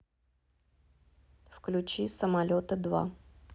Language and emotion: Russian, neutral